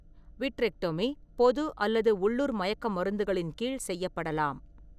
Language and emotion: Tamil, neutral